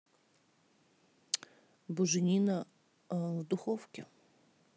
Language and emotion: Russian, neutral